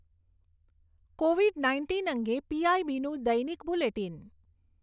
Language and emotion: Gujarati, neutral